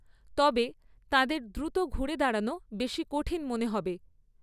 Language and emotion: Bengali, neutral